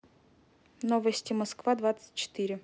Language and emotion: Russian, neutral